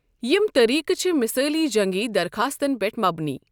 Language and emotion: Kashmiri, neutral